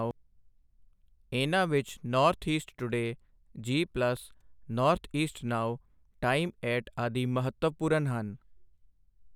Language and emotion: Punjabi, neutral